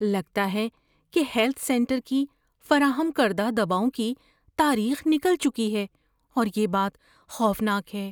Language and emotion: Urdu, fearful